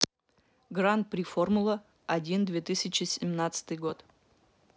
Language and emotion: Russian, neutral